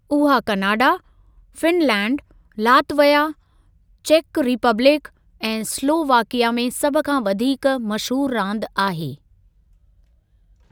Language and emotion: Sindhi, neutral